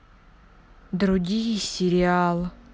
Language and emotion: Russian, sad